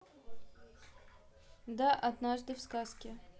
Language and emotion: Russian, neutral